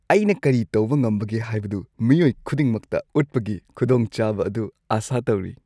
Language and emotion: Manipuri, happy